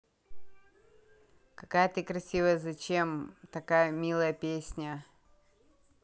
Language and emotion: Russian, positive